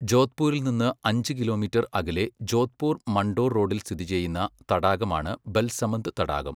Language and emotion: Malayalam, neutral